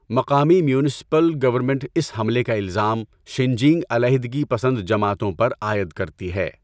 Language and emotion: Urdu, neutral